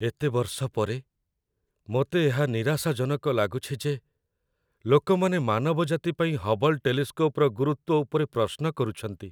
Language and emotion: Odia, sad